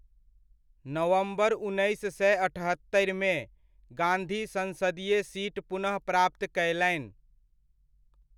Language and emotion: Maithili, neutral